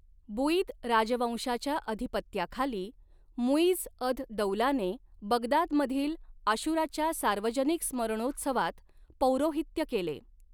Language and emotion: Marathi, neutral